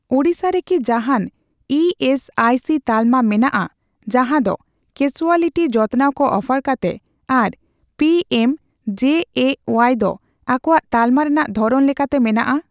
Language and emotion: Santali, neutral